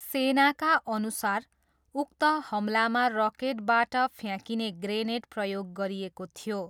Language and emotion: Nepali, neutral